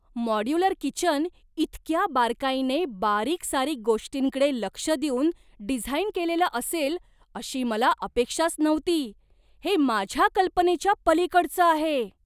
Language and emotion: Marathi, surprised